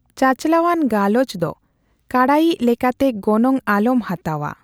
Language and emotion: Santali, neutral